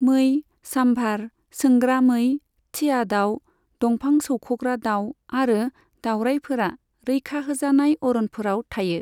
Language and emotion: Bodo, neutral